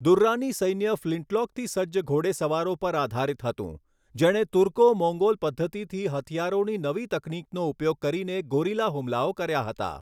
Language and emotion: Gujarati, neutral